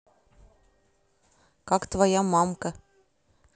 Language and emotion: Russian, neutral